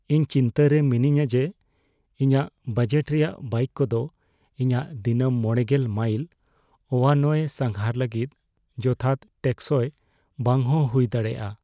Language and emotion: Santali, fearful